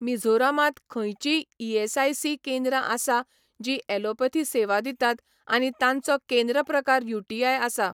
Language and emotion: Goan Konkani, neutral